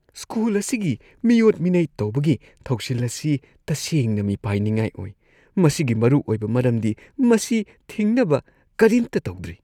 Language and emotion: Manipuri, disgusted